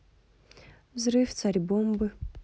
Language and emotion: Russian, neutral